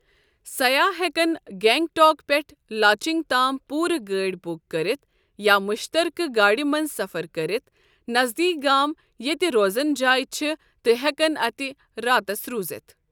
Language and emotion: Kashmiri, neutral